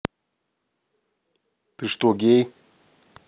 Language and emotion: Russian, neutral